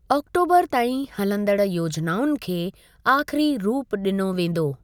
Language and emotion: Sindhi, neutral